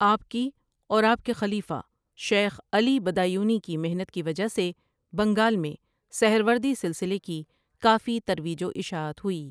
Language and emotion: Urdu, neutral